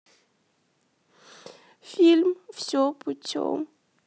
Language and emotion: Russian, sad